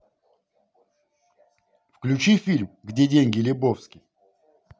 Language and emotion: Russian, positive